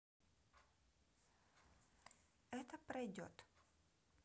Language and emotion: Russian, neutral